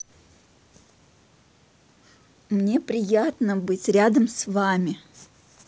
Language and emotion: Russian, positive